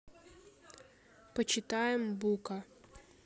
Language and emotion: Russian, neutral